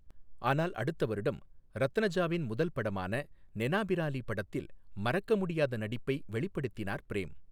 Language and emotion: Tamil, neutral